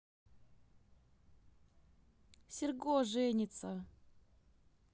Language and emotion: Russian, positive